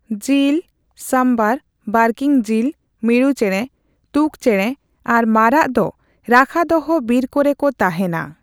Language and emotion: Santali, neutral